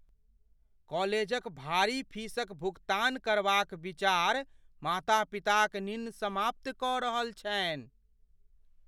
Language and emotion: Maithili, fearful